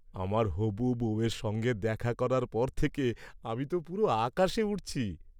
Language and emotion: Bengali, happy